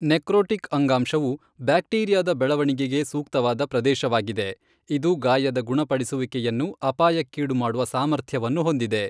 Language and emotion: Kannada, neutral